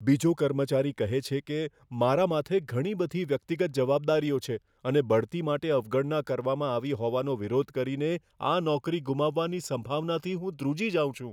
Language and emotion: Gujarati, fearful